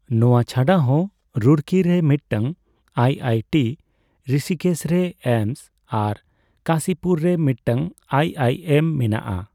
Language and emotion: Santali, neutral